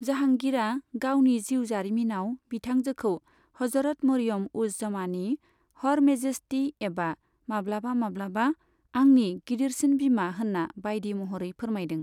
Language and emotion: Bodo, neutral